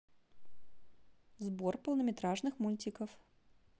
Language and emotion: Russian, neutral